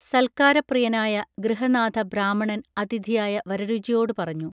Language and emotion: Malayalam, neutral